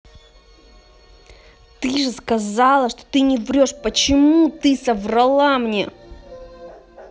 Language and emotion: Russian, angry